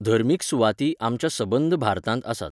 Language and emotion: Goan Konkani, neutral